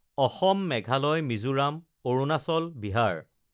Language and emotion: Assamese, neutral